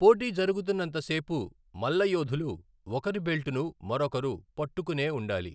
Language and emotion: Telugu, neutral